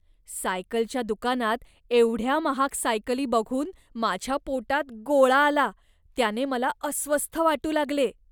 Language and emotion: Marathi, disgusted